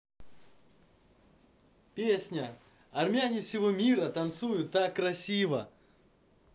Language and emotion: Russian, positive